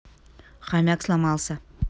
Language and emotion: Russian, neutral